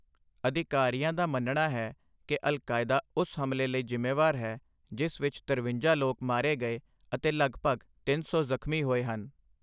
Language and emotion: Punjabi, neutral